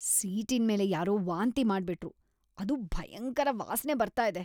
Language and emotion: Kannada, disgusted